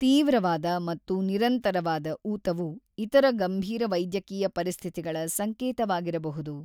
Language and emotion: Kannada, neutral